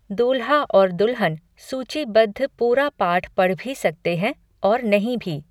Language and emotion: Hindi, neutral